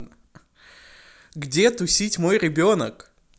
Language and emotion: Russian, neutral